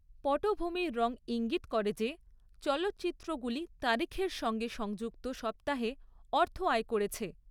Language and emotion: Bengali, neutral